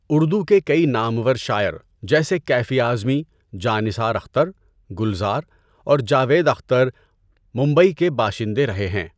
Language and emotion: Urdu, neutral